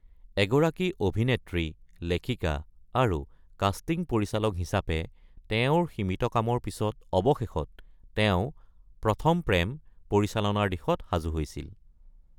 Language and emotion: Assamese, neutral